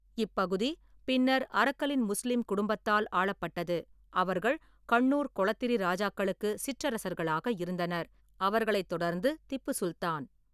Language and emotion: Tamil, neutral